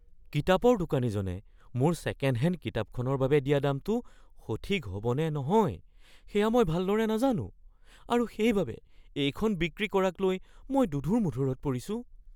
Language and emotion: Assamese, fearful